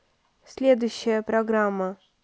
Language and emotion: Russian, neutral